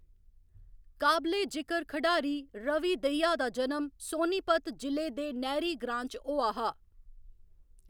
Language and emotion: Dogri, neutral